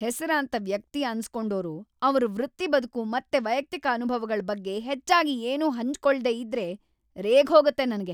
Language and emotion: Kannada, angry